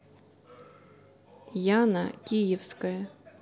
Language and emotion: Russian, neutral